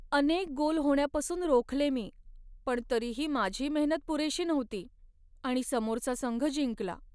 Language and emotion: Marathi, sad